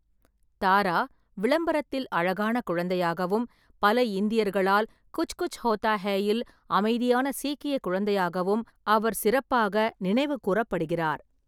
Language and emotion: Tamil, neutral